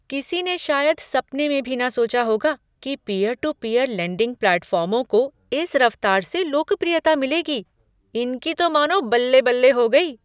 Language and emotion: Hindi, surprised